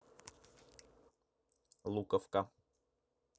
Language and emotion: Russian, neutral